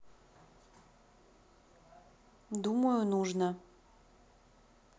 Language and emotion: Russian, neutral